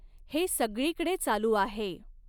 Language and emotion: Marathi, neutral